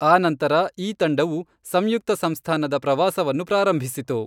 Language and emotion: Kannada, neutral